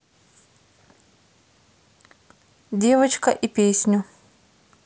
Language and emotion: Russian, neutral